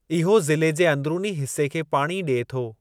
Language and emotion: Sindhi, neutral